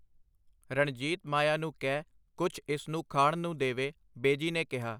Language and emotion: Punjabi, neutral